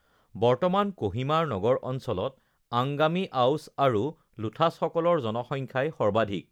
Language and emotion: Assamese, neutral